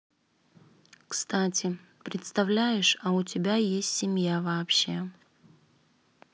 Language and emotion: Russian, neutral